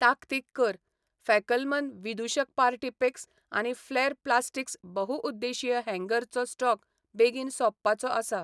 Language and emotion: Goan Konkani, neutral